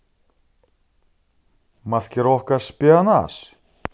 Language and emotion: Russian, positive